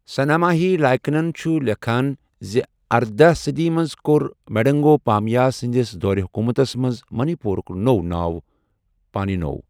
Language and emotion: Kashmiri, neutral